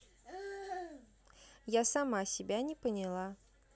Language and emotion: Russian, neutral